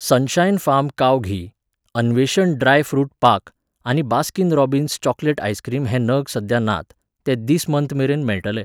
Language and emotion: Goan Konkani, neutral